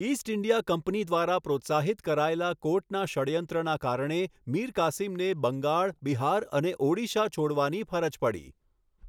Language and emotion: Gujarati, neutral